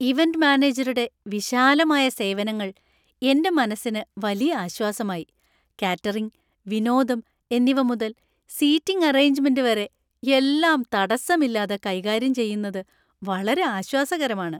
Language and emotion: Malayalam, happy